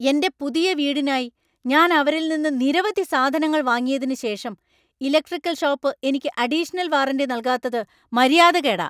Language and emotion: Malayalam, angry